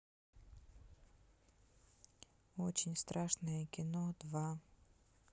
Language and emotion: Russian, neutral